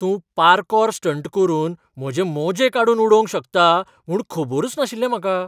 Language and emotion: Goan Konkani, surprised